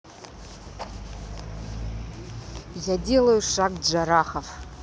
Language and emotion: Russian, neutral